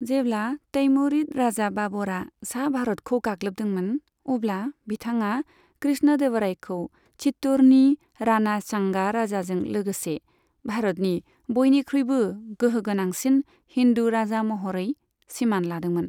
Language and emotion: Bodo, neutral